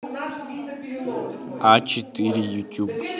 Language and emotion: Russian, neutral